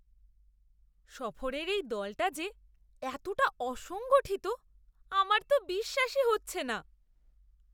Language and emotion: Bengali, disgusted